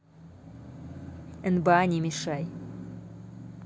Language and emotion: Russian, neutral